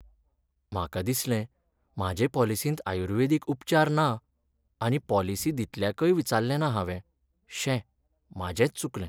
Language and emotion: Goan Konkani, sad